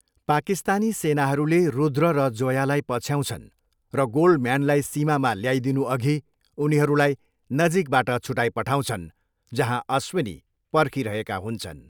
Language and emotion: Nepali, neutral